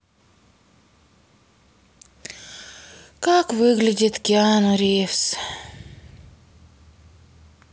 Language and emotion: Russian, sad